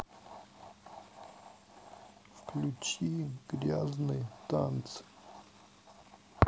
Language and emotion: Russian, sad